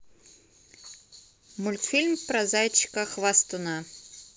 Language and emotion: Russian, neutral